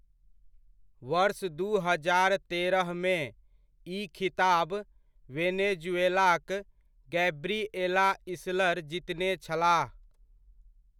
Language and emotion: Maithili, neutral